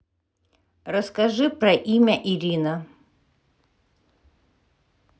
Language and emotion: Russian, neutral